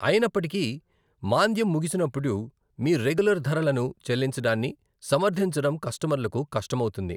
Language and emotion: Telugu, neutral